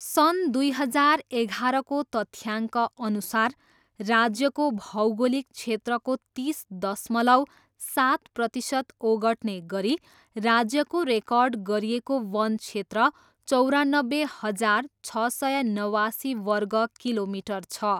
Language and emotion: Nepali, neutral